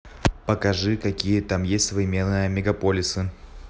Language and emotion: Russian, neutral